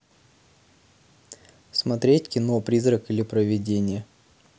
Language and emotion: Russian, neutral